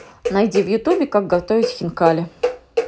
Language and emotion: Russian, positive